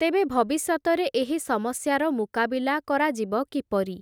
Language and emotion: Odia, neutral